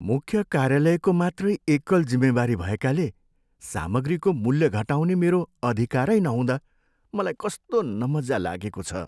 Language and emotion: Nepali, sad